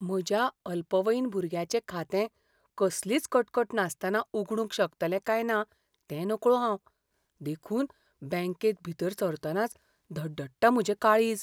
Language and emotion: Goan Konkani, fearful